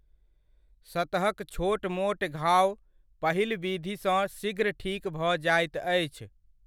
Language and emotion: Maithili, neutral